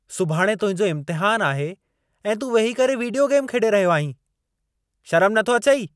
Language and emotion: Sindhi, angry